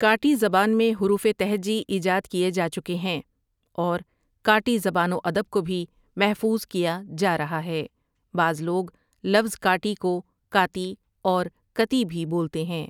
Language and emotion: Urdu, neutral